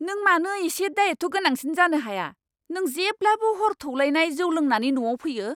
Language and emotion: Bodo, angry